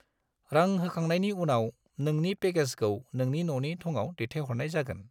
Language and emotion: Bodo, neutral